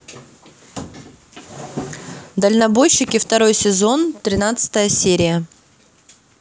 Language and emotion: Russian, neutral